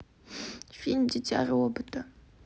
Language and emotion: Russian, sad